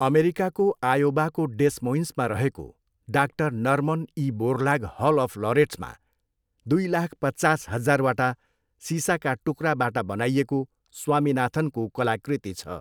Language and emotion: Nepali, neutral